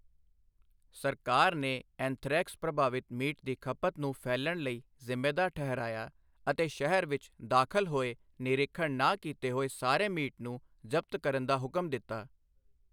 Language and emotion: Punjabi, neutral